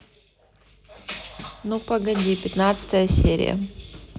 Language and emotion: Russian, neutral